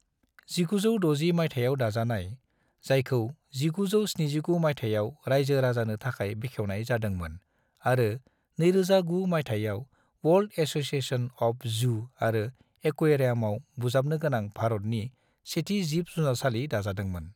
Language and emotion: Bodo, neutral